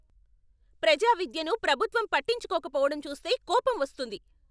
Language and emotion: Telugu, angry